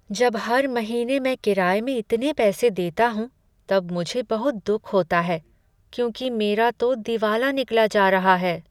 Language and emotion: Hindi, sad